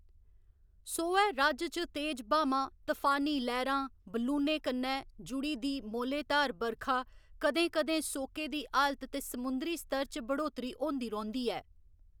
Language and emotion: Dogri, neutral